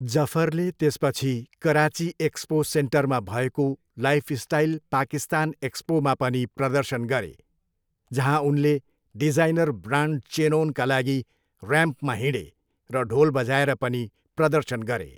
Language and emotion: Nepali, neutral